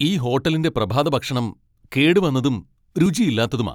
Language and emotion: Malayalam, angry